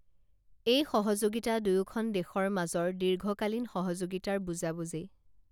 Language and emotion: Assamese, neutral